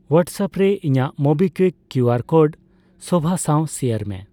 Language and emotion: Santali, neutral